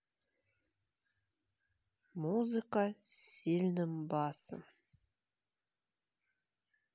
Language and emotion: Russian, sad